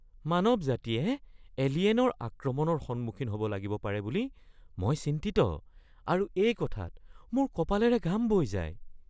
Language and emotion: Assamese, fearful